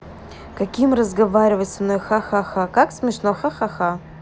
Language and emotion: Russian, neutral